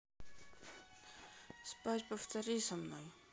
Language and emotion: Russian, sad